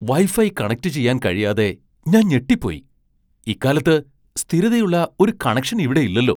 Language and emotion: Malayalam, surprised